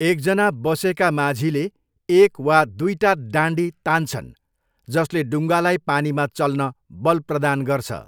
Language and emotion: Nepali, neutral